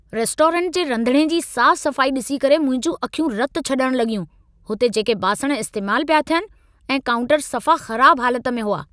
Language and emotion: Sindhi, angry